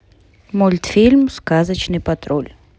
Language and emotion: Russian, neutral